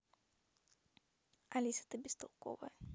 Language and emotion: Russian, neutral